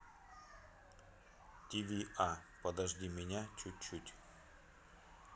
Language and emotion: Russian, neutral